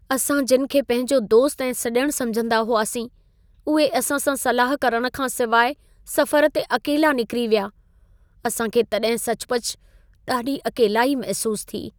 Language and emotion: Sindhi, sad